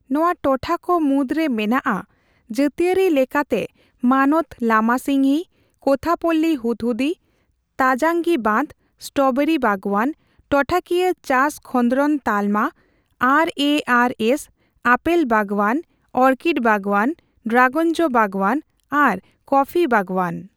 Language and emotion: Santali, neutral